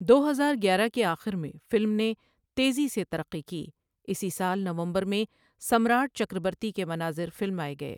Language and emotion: Urdu, neutral